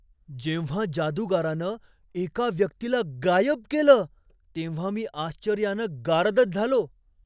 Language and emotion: Marathi, surprised